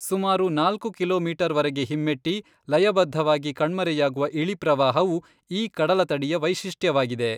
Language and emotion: Kannada, neutral